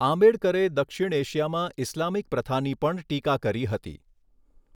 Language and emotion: Gujarati, neutral